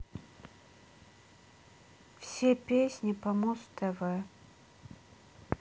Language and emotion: Russian, sad